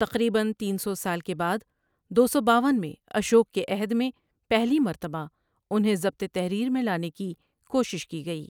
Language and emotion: Urdu, neutral